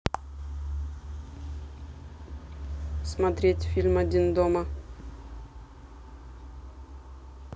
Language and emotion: Russian, neutral